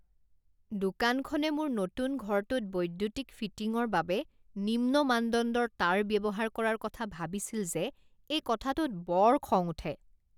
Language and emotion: Assamese, disgusted